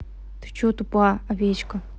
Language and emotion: Russian, angry